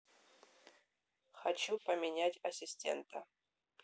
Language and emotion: Russian, neutral